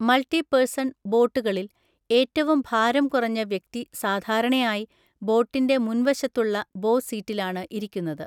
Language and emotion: Malayalam, neutral